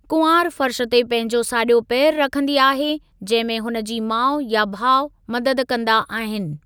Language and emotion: Sindhi, neutral